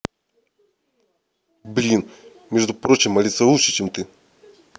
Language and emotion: Russian, angry